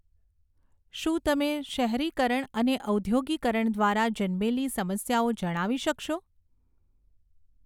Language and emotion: Gujarati, neutral